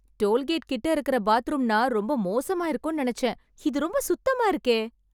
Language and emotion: Tamil, surprised